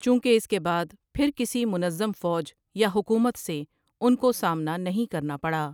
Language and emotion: Urdu, neutral